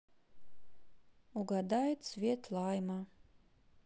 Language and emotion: Russian, sad